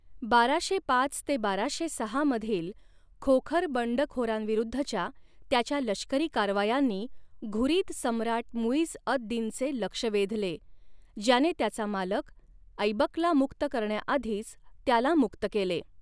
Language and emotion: Marathi, neutral